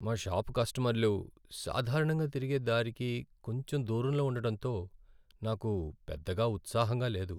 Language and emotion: Telugu, sad